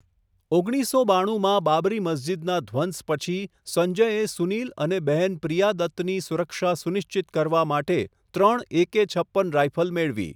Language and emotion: Gujarati, neutral